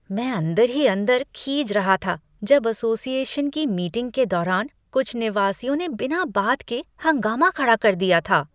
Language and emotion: Hindi, disgusted